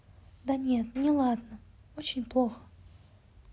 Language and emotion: Russian, sad